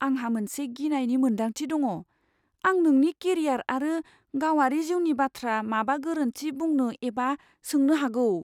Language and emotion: Bodo, fearful